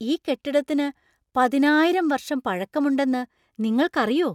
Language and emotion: Malayalam, surprised